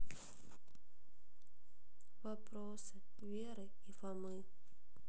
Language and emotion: Russian, sad